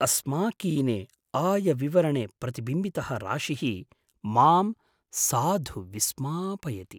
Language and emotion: Sanskrit, surprised